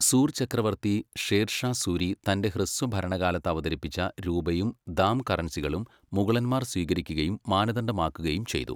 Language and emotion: Malayalam, neutral